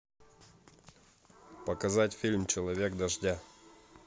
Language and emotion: Russian, neutral